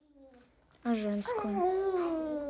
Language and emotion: Russian, neutral